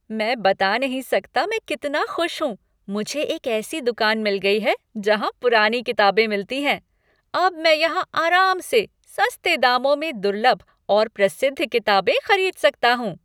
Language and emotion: Hindi, happy